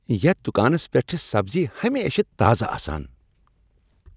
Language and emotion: Kashmiri, happy